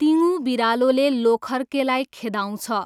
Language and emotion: Nepali, neutral